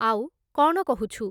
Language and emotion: Odia, neutral